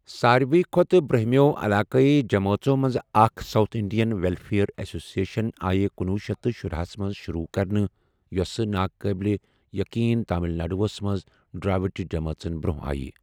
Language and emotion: Kashmiri, neutral